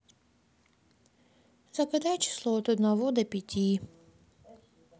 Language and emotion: Russian, sad